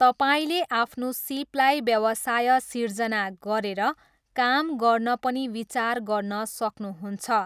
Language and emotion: Nepali, neutral